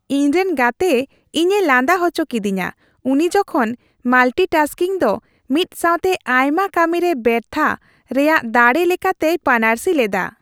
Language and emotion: Santali, happy